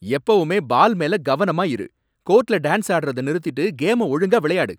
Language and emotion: Tamil, angry